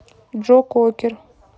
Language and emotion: Russian, neutral